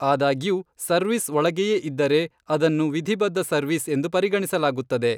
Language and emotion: Kannada, neutral